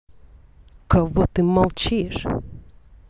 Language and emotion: Russian, angry